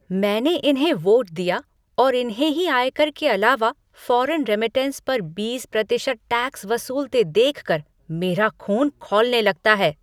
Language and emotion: Hindi, angry